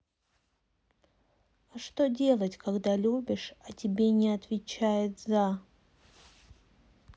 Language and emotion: Russian, sad